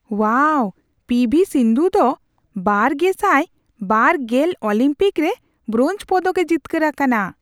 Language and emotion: Santali, surprised